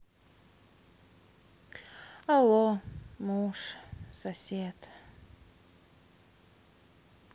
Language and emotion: Russian, sad